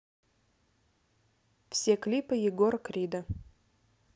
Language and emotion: Russian, neutral